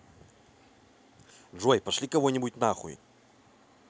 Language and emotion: Russian, angry